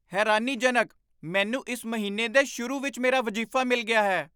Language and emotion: Punjabi, surprised